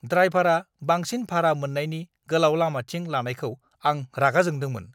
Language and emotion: Bodo, angry